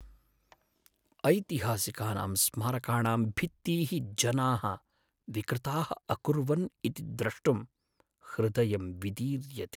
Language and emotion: Sanskrit, sad